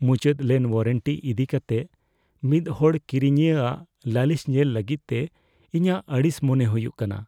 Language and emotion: Santali, fearful